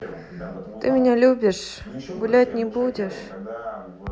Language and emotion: Russian, sad